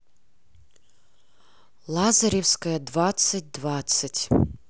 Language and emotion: Russian, neutral